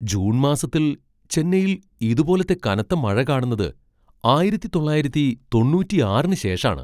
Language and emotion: Malayalam, surprised